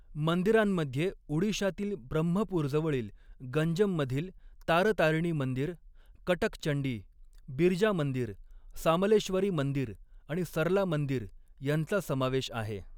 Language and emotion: Marathi, neutral